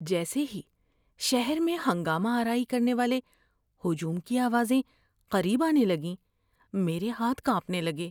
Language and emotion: Urdu, fearful